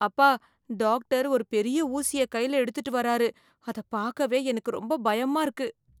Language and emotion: Tamil, fearful